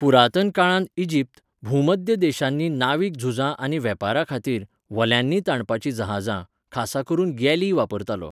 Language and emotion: Goan Konkani, neutral